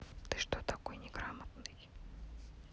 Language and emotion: Russian, neutral